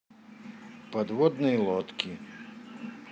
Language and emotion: Russian, neutral